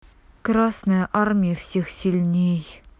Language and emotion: Russian, neutral